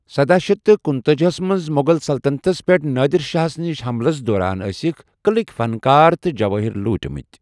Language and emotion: Kashmiri, neutral